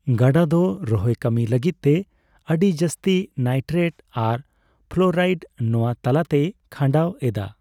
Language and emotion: Santali, neutral